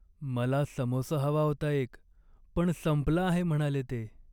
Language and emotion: Marathi, sad